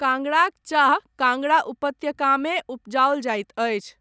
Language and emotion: Maithili, neutral